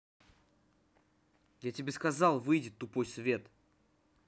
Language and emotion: Russian, angry